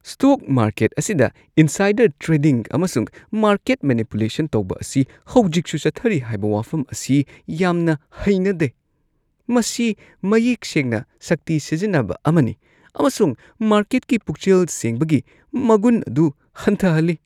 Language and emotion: Manipuri, disgusted